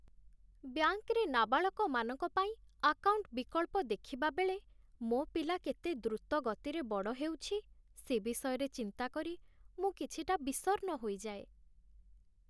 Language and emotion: Odia, sad